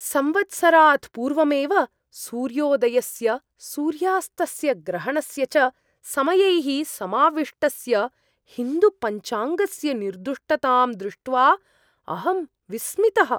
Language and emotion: Sanskrit, surprised